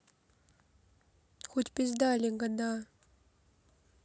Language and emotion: Russian, neutral